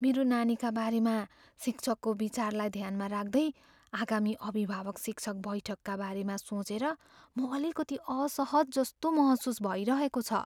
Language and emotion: Nepali, fearful